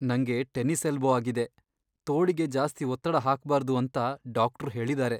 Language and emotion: Kannada, sad